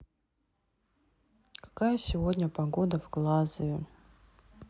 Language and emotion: Russian, sad